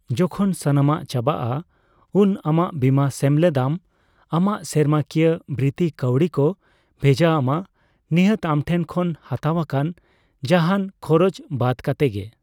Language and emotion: Santali, neutral